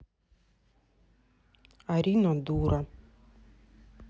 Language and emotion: Russian, neutral